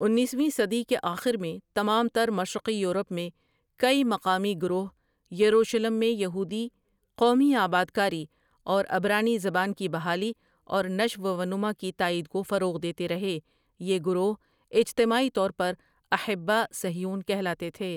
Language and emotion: Urdu, neutral